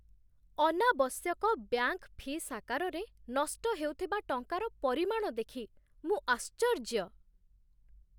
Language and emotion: Odia, surprised